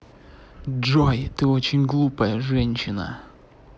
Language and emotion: Russian, angry